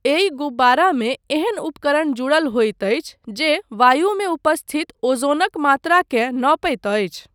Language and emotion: Maithili, neutral